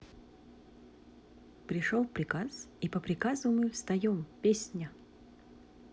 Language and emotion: Russian, positive